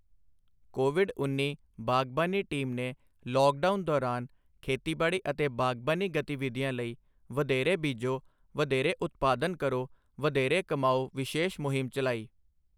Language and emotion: Punjabi, neutral